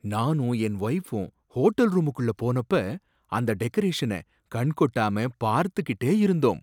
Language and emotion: Tamil, surprised